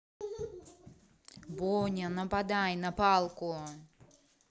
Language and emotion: Russian, angry